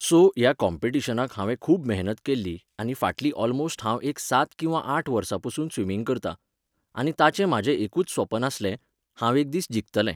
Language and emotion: Goan Konkani, neutral